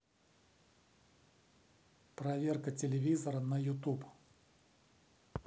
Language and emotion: Russian, neutral